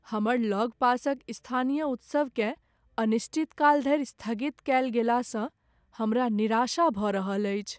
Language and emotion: Maithili, sad